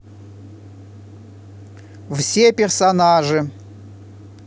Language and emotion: Russian, positive